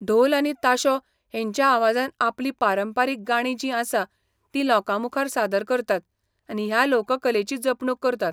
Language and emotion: Goan Konkani, neutral